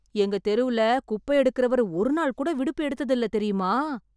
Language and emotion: Tamil, surprised